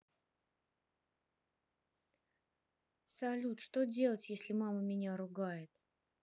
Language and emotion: Russian, sad